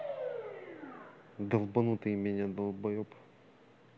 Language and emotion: Russian, angry